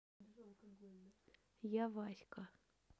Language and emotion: Russian, neutral